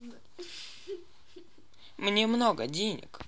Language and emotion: Russian, neutral